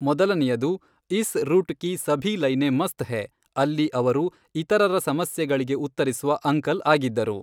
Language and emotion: Kannada, neutral